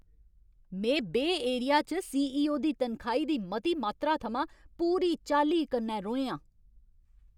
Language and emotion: Dogri, angry